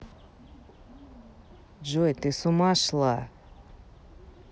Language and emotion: Russian, neutral